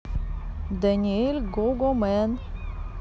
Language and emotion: Russian, neutral